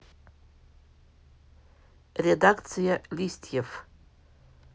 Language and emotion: Russian, neutral